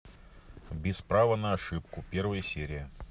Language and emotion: Russian, neutral